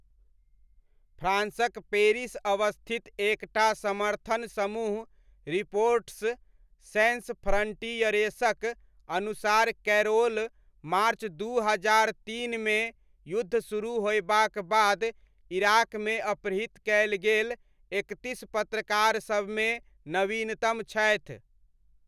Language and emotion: Maithili, neutral